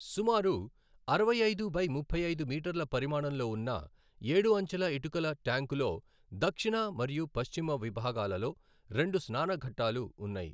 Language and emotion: Telugu, neutral